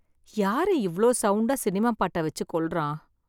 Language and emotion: Tamil, sad